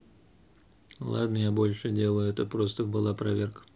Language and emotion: Russian, neutral